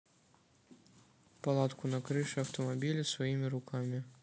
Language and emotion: Russian, neutral